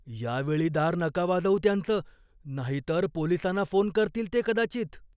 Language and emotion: Marathi, fearful